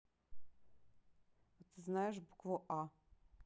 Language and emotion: Russian, neutral